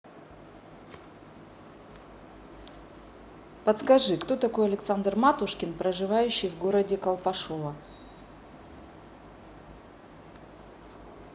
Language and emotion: Russian, neutral